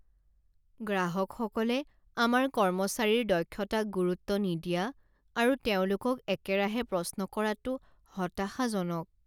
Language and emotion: Assamese, sad